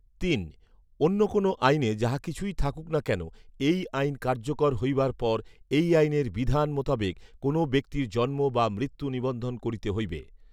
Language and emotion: Bengali, neutral